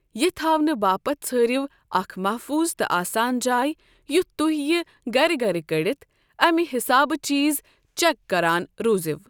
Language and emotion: Kashmiri, neutral